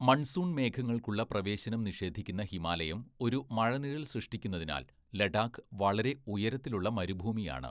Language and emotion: Malayalam, neutral